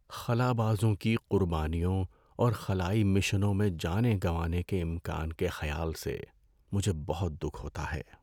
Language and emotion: Urdu, sad